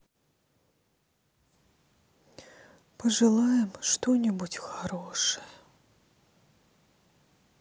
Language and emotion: Russian, sad